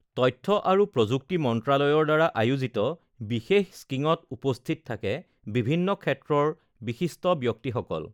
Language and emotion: Assamese, neutral